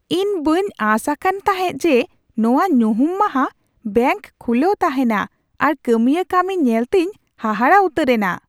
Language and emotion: Santali, surprised